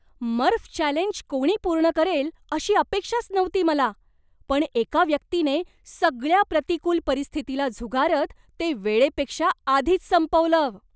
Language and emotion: Marathi, surprised